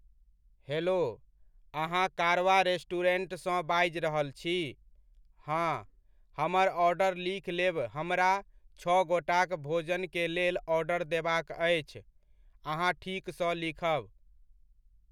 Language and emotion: Maithili, neutral